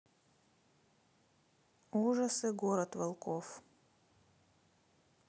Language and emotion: Russian, neutral